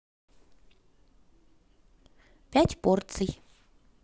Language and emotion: Russian, positive